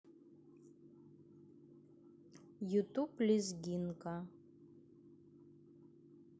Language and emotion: Russian, neutral